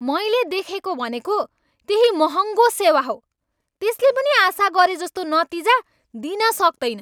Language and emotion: Nepali, angry